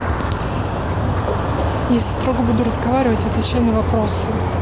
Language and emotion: Russian, neutral